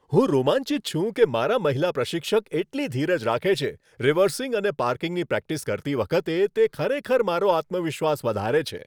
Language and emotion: Gujarati, happy